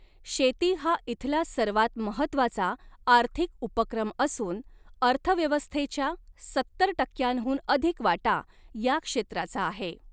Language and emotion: Marathi, neutral